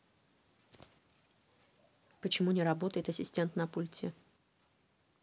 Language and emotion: Russian, neutral